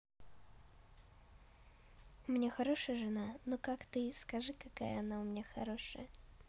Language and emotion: Russian, positive